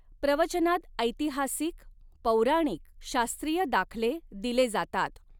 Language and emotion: Marathi, neutral